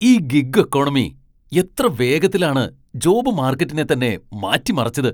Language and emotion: Malayalam, surprised